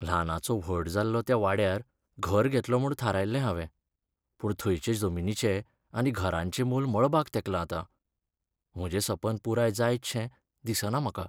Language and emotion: Goan Konkani, sad